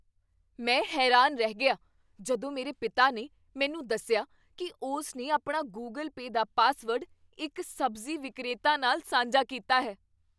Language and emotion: Punjabi, surprised